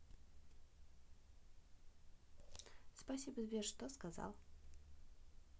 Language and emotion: Russian, neutral